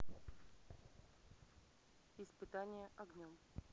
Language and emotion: Russian, neutral